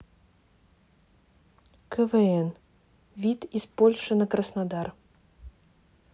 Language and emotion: Russian, neutral